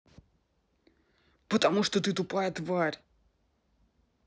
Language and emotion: Russian, angry